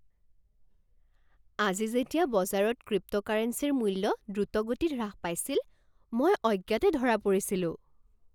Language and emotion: Assamese, surprised